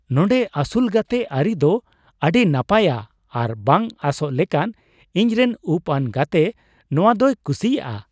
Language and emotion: Santali, surprised